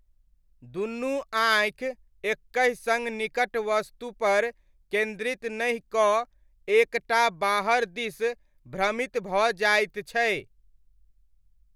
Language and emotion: Maithili, neutral